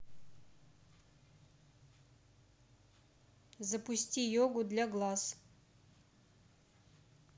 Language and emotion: Russian, neutral